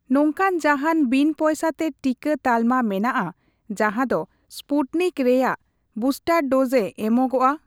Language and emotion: Santali, neutral